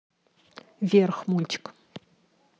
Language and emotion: Russian, neutral